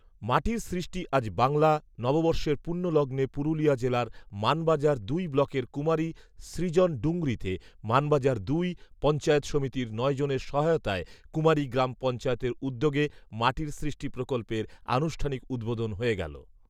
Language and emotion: Bengali, neutral